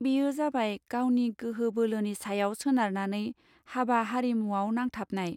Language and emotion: Bodo, neutral